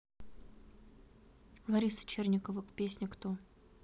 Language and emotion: Russian, neutral